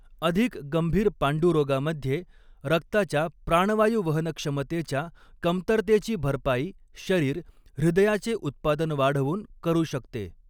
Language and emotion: Marathi, neutral